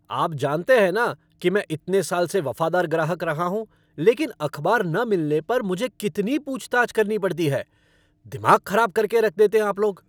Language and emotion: Hindi, angry